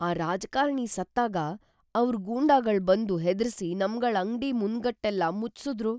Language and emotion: Kannada, fearful